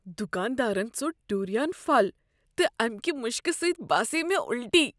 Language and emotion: Kashmiri, disgusted